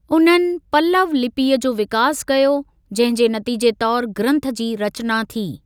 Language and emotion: Sindhi, neutral